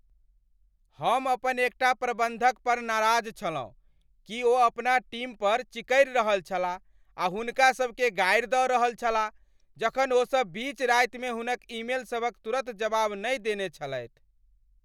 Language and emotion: Maithili, angry